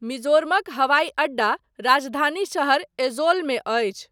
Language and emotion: Maithili, neutral